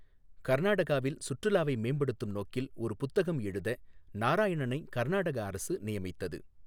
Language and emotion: Tamil, neutral